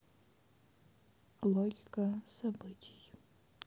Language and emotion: Russian, sad